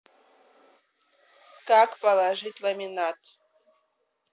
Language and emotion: Russian, neutral